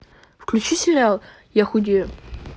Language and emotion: Russian, neutral